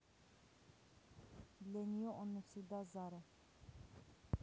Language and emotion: Russian, neutral